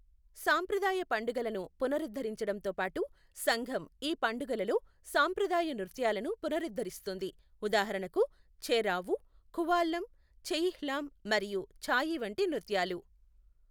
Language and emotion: Telugu, neutral